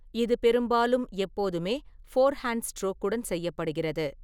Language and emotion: Tamil, neutral